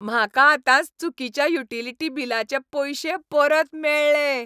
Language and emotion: Goan Konkani, happy